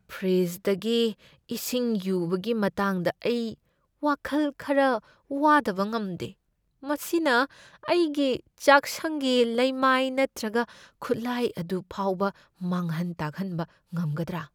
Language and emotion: Manipuri, fearful